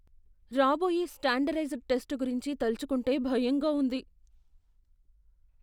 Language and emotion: Telugu, fearful